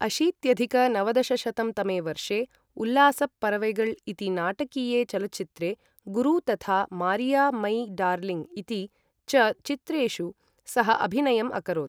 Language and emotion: Sanskrit, neutral